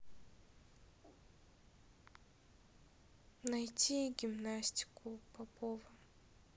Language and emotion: Russian, sad